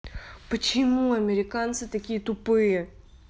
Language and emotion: Russian, angry